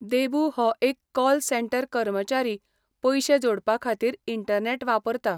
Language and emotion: Goan Konkani, neutral